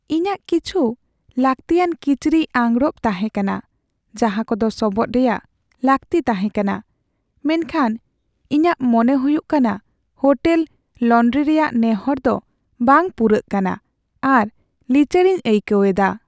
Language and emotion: Santali, sad